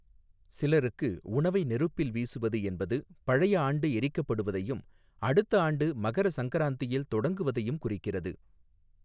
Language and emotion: Tamil, neutral